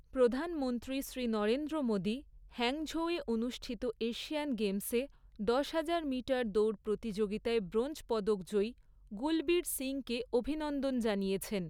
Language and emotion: Bengali, neutral